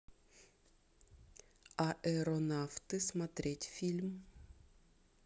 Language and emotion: Russian, neutral